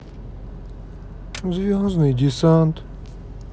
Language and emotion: Russian, sad